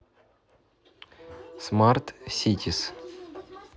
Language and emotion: Russian, neutral